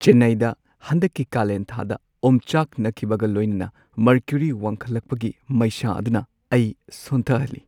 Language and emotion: Manipuri, sad